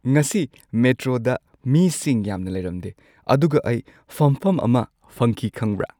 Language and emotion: Manipuri, happy